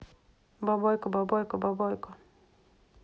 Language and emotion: Russian, neutral